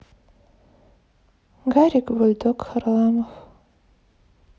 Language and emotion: Russian, sad